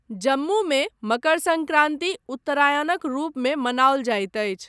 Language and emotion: Maithili, neutral